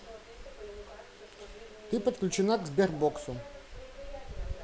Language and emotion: Russian, neutral